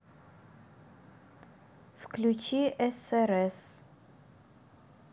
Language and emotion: Russian, neutral